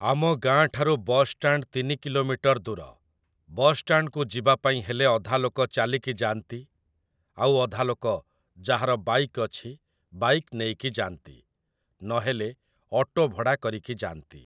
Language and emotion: Odia, neutral